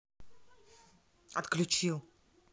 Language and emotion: Russian, angry